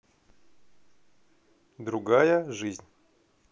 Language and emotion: Russian, neutral